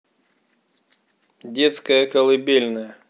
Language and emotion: Russian, neutral